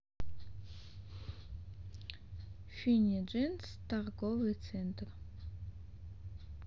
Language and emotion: Russian, neutral